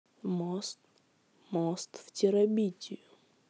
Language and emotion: Russian, neutral